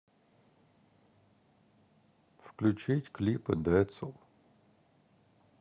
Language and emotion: Russian, sad